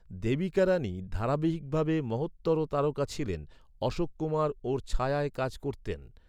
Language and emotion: Bengali, neutral